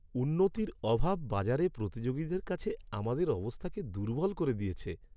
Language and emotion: Bengali, sad